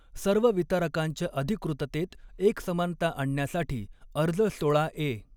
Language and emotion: Marathi, neutral